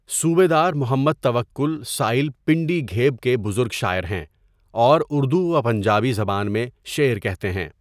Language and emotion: Urdu, neutral